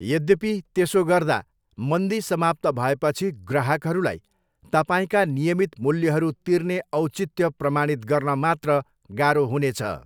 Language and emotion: Nepali, neutral